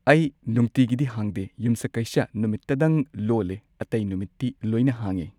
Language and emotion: Manipuri, neutral